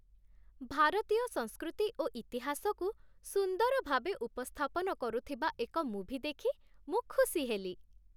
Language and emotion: Odia, happy